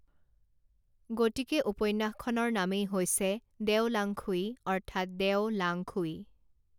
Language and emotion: Assamese, neutral